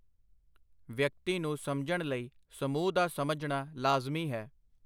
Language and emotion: Punjabi, neutral